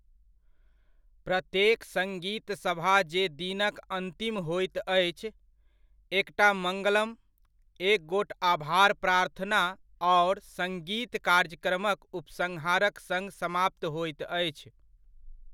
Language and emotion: Maithili, neutral